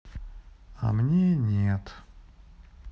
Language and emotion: Russian, sad